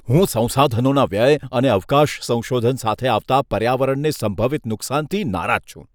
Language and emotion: Gujarati, disgusted